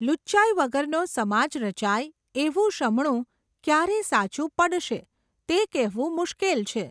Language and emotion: Gujarati, neutral